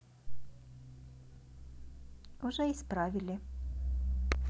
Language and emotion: Russian, neutral